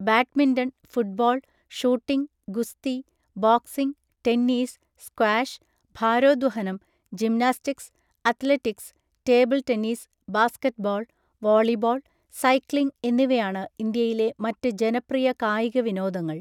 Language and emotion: Malayalam, neutral